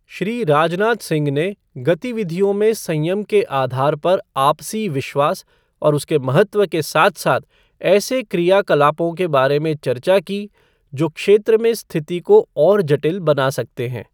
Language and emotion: Hindi, neutral